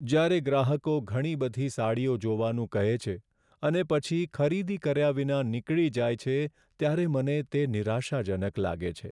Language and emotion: Gujarati, sad